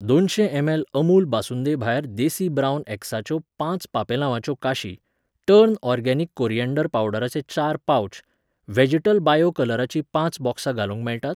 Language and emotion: Goan Konkani, neutral